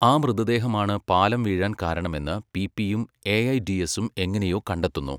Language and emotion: Malayalam, neutral